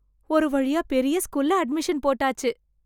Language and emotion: Tamil, happy